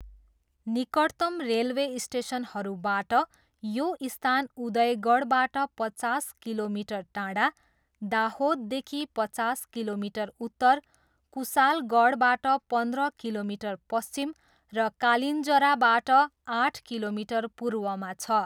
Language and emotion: Nepali, neutral